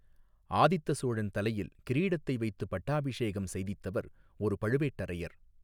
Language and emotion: Tamil, neutral